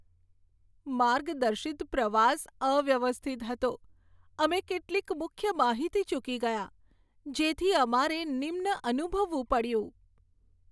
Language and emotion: Gujarati, sad